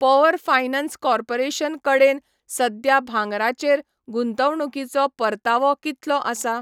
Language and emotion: Goan Konkani, neutral